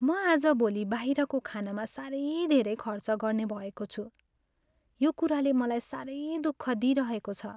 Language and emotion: Nepali, sad